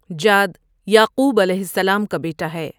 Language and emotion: Urdu, neutral